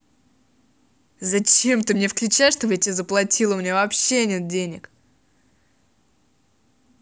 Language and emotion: Russian, angry